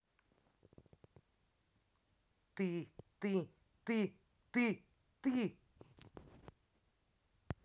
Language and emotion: Russian, angry